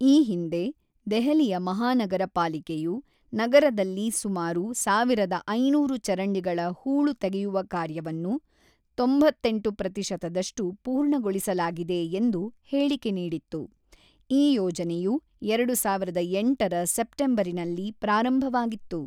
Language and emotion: Kannada, neutral